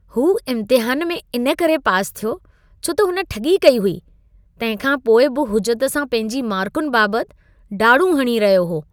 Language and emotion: Sindhi, disgusted